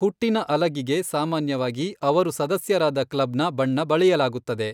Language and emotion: Kannada, neutral